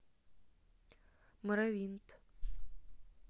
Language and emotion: Russian, neutral